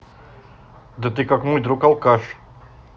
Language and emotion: Russian, angry